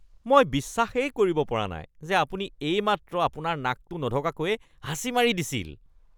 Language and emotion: Assamese, disgusted